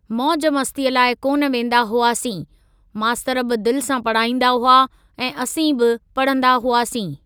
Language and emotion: Sindhi, neutral